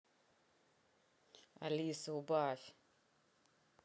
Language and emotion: Russian, angry